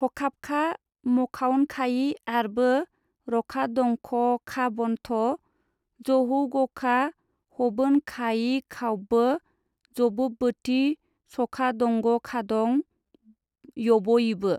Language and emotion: Bodo, neutral